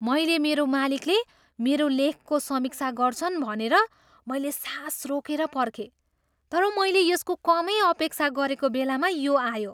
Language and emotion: Nepali, surprised